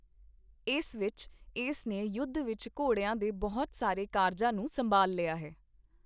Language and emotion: Punjabi, neutral